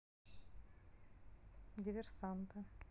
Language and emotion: Russian, neutral